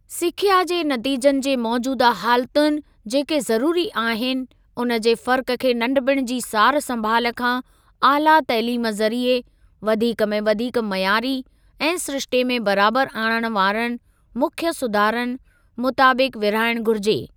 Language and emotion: Sindhi, neutral